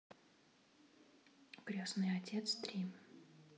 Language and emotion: Russian, neutral